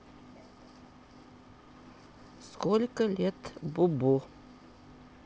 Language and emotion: Russian, neutral